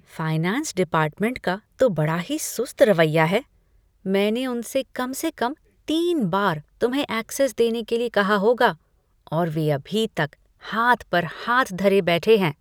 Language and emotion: Hindi, disgusted